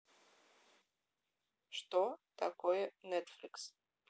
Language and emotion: Russian, neutral